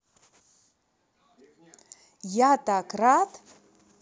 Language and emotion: Russian, positive